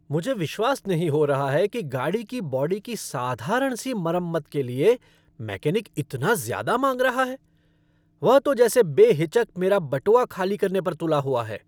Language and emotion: Hindi, angry